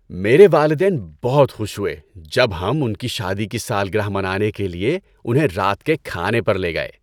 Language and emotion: Urdu, happy